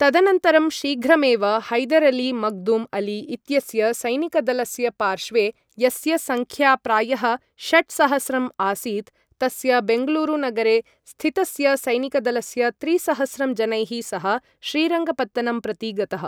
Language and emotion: Sanskrit, neutral